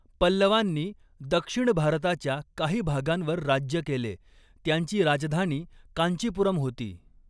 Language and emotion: Marathi, neutral